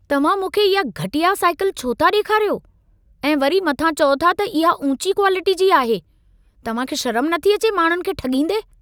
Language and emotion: Sindhi, angry